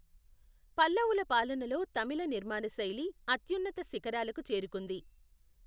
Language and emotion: Telugu, neutral